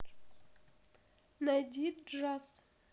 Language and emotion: Russian, neutral